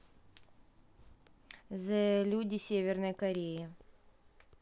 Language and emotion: Russian, neutral